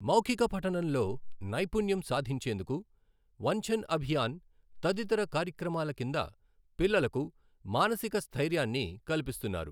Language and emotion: Telugu, neutral